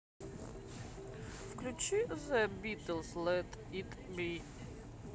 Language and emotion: Russian, neutral